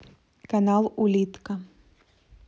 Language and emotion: Russian, neutral